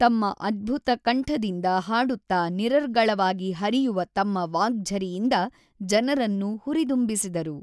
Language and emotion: Kannada, neutral